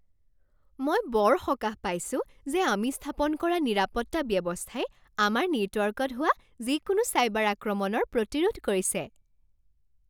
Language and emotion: Assamese, happy